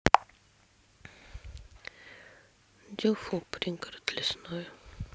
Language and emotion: Russian, sad